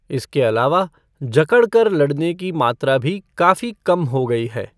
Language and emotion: Hindi, neutral